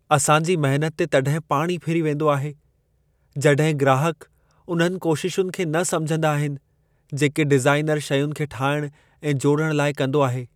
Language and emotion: Sindhi, sad